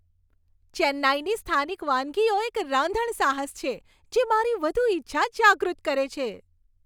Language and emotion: Gujarati, happy